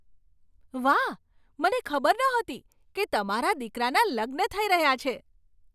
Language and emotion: Gujarati, surprised